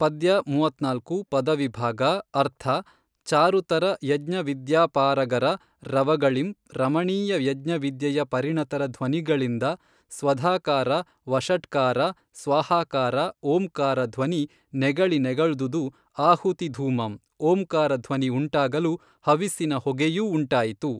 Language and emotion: Kannada, neutral